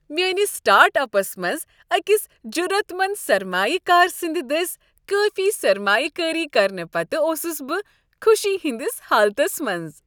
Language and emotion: Kashmiri, happy